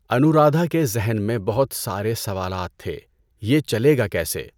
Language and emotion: Urdu, neutral